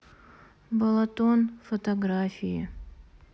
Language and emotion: Russian, sad